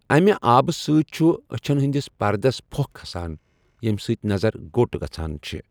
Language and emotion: Kashmiri, neutral